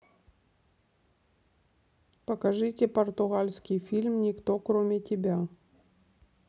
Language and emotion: Russian, neutral